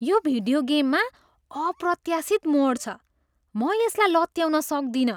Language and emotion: Nepali, surprised